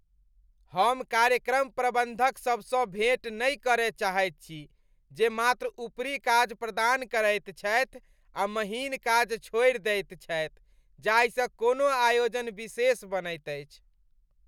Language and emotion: Maithili, disgusted